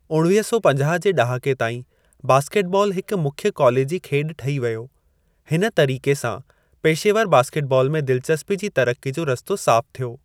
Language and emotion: Sindhi, neutral